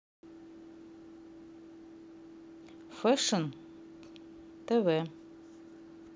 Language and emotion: Russian, neutral